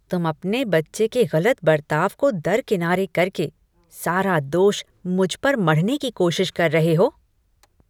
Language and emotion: Hindi, disgusted